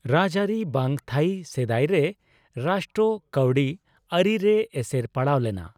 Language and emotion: Santali, neutral